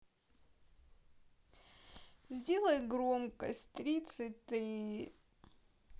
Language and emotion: Russian, sad